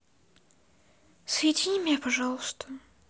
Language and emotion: Russian, sad